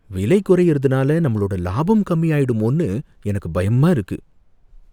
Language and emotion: Tamil, fearful